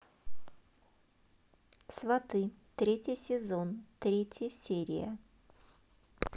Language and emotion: Russian, neutral